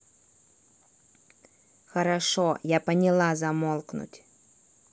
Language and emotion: Russian, angry